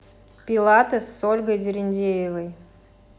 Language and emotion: Russian, neutral